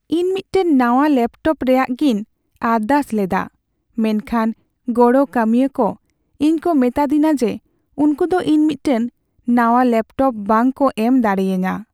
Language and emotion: Santali, sad